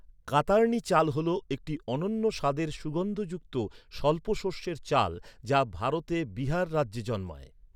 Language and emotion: Bengali, neutral